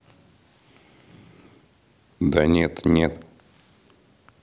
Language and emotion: Russian, neutral